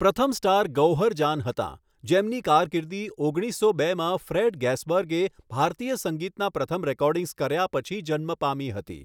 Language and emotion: Gujarati, neutral